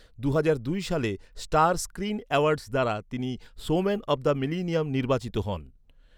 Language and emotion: Bengali, neutral